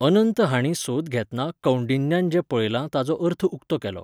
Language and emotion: Goan Konkani, neutral